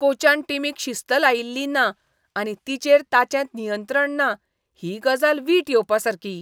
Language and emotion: Goan Konkani, disgusted